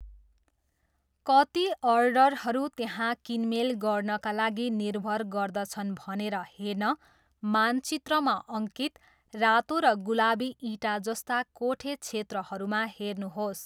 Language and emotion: Nepali, neutral